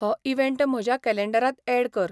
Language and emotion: Goan Konkani, neutral